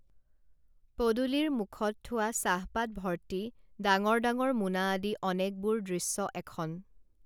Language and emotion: Assamese, neutral